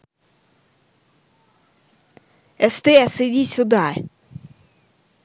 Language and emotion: Russian, angry